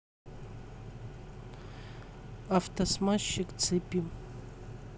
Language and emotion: Russian, neutral